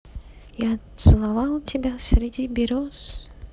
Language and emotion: Russian, neutral